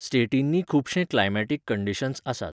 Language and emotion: Goan Konkani, neutral